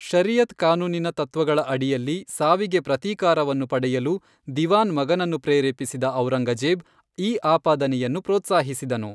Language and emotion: Kannada, neutral